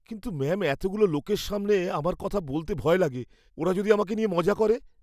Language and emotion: Bengali, fearful